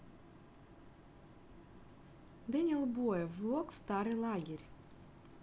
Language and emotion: Russian, neutral